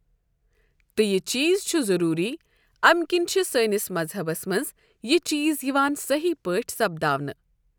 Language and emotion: Kashmiri, neutral